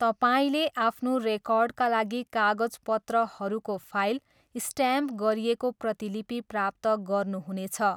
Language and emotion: Nepali, neutral